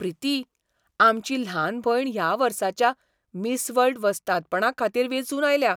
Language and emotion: Goan Konkani, surprised